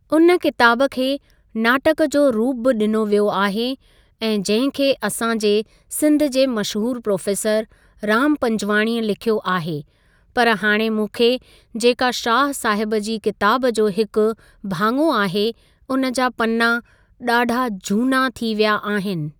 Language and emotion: Sindhi, neutral